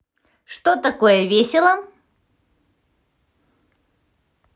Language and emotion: Russian, positive